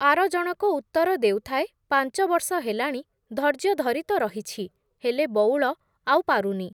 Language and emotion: Odia, neutral